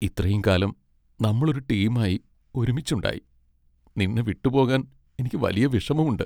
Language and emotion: Malayalam, sad